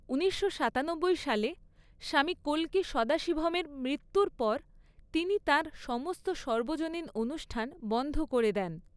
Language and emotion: Bengali, neutral